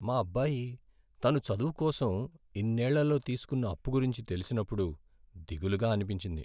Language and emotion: Telugu, sad